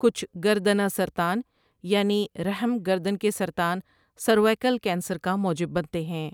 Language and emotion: Urdu, neutral